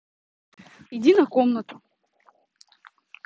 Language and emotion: Russian, neutral